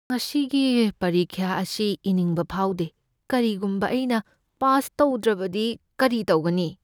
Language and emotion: Manipuri, fearful